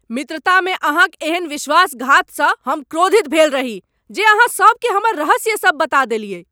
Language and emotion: Maithili, angry